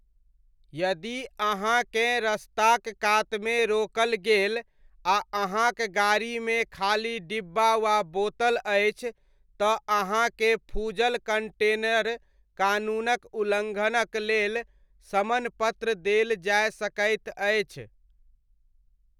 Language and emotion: Maithili, neutral